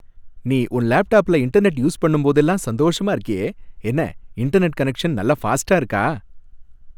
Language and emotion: Tamil, happy